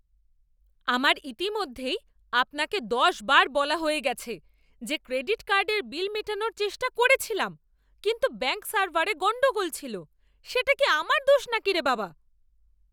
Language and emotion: Bengali, angry